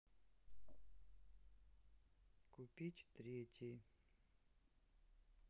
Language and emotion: Russian, neutral